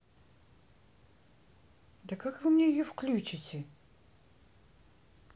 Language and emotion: Russian, neutral